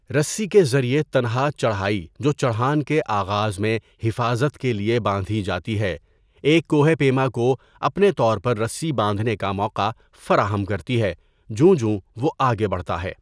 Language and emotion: Urdu, neutral